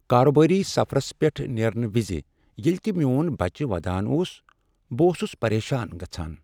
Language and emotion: Kashmiri, sad